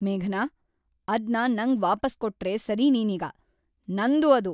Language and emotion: Kannada, angry